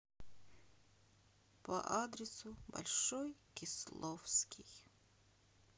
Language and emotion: Russian, sad